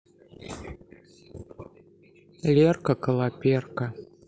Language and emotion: Russian, sad